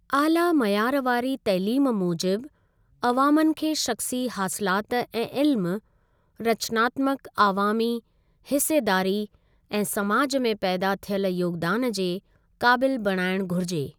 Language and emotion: Sindhi, neutral